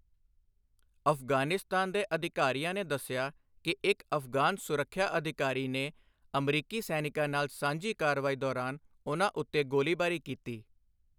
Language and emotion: Punjabi, neutral